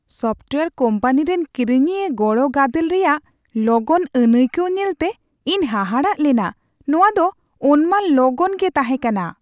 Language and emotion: Santali, surprised